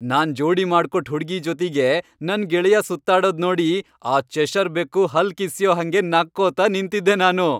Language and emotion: Kannada, happy